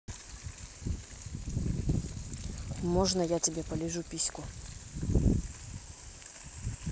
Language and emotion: Russian, neutral